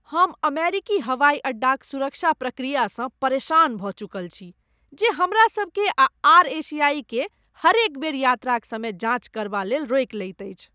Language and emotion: Maithili, disgusted